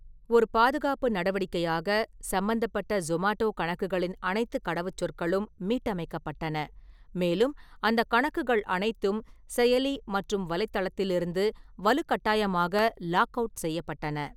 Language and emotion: Tamil, neutral